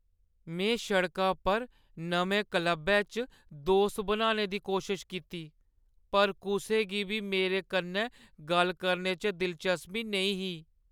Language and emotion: Dogri, sad